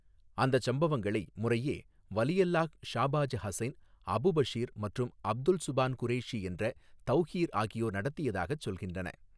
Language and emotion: Tamil, neutral